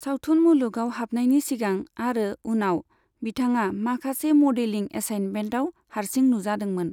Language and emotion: Bodo, neutral